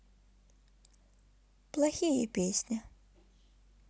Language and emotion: Russian, sad